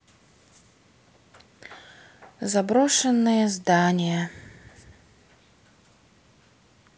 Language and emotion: Russian, sad